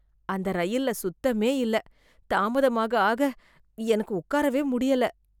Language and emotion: Tamil, disgusted